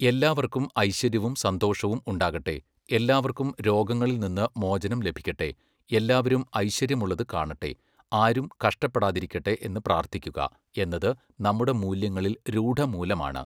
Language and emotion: Malayalam, neutral